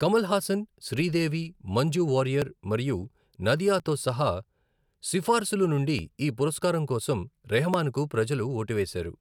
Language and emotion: Telugu, neutral